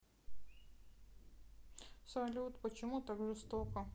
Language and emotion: Russian, sad